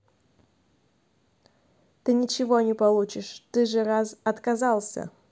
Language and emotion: Russian, neutral